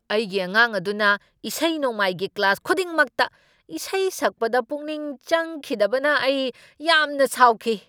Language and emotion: Manipuri, angry